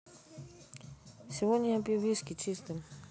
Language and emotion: Russian, neutral